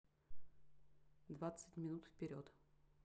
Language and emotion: Russian, neutral